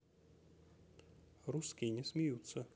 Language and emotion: Russian, neutral